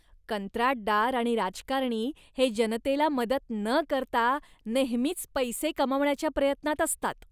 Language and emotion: Marathi, disgusted